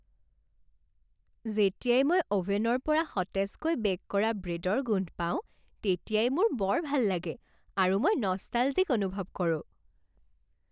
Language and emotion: Assamese, happy